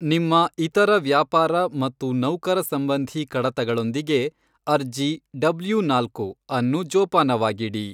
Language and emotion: Kannada, neutral